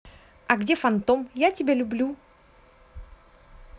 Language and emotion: Russian, positive